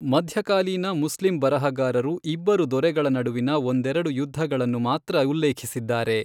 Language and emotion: Kannada, neutral